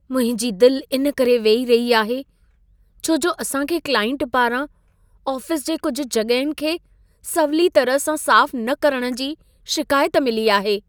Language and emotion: Sindhi, sad